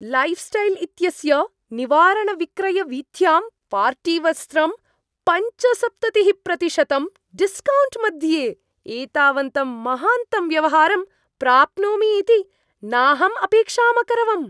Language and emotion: Sanskrit, surprised